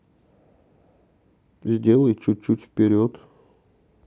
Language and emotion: Russian, neutral